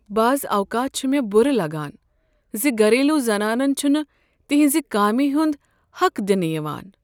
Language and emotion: Kashmiri, sad